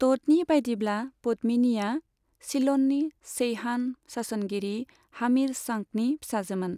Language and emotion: Bodo, neutral